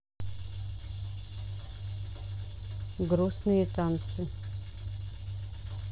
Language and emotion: Russian, neutral